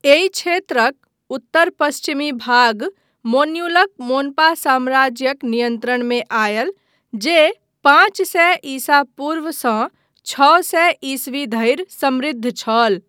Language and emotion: Maithili, neutral